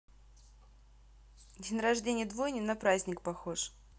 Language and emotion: Russian, neutral